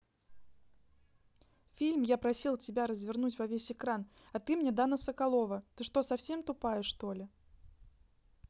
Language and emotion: Russian, angry